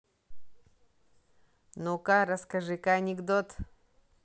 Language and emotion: Russian, neutral